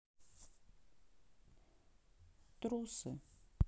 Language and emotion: Russian, sad